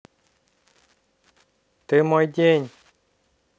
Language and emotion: Russian, positive